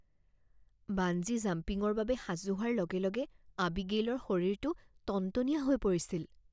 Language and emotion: Assamese, fearful